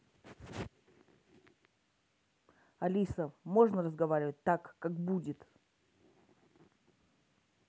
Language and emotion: Russian, angry